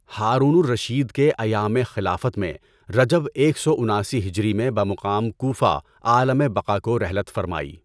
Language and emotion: Urdu, neutral